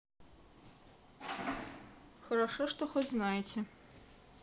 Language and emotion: Russian, neutral